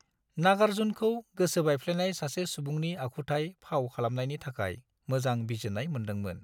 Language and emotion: Bodo, neutral